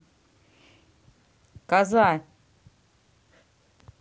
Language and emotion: Russian, neutral